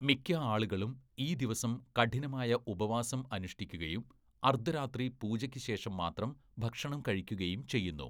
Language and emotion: Malayalam, neutral